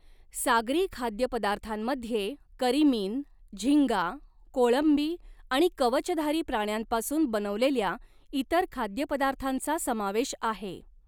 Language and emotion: Marathi, neutral